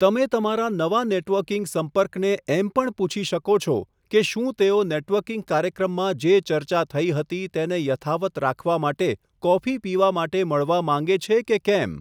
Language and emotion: Gujarati, neutral